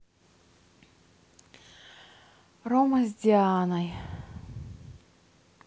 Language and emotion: Russian, sad